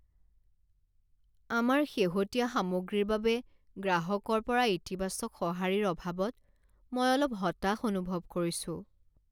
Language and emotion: Assamese, sad